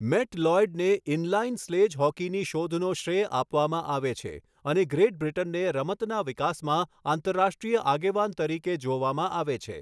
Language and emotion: Gujarati, neutral